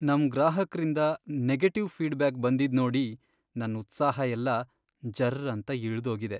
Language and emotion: Kannada, sad